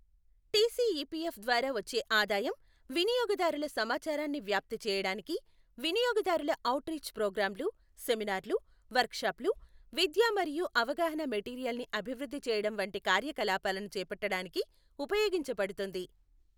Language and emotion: Telugu, neutral